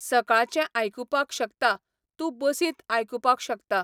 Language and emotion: Goan Konkani, neutral